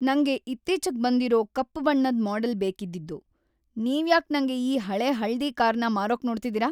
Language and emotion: Kannada, angry